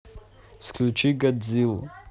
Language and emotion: Russian, neutral